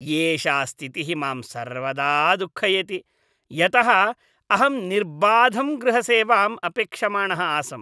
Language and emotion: Sanskrit, disgusted